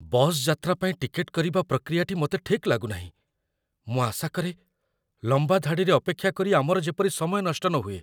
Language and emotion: Odia, fearful